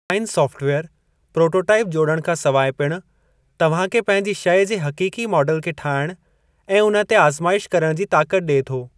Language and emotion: Sindhi, neutral